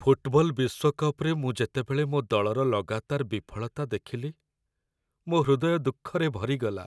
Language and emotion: Odia, sad